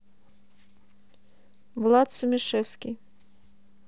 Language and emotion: Russian, neutral